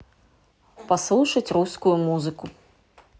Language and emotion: Russian, neutral